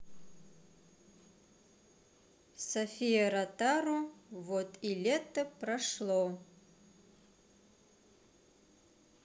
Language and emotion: Russian, neutral